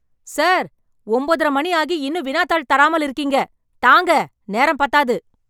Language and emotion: Tamil, angry